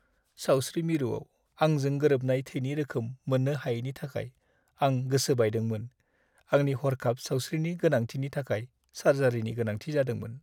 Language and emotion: Bodo, sad